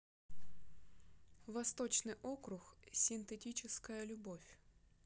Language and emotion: Russian, neutral